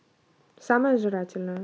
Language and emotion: Russian, neutral